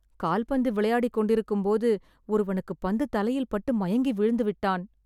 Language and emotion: Tamil, sad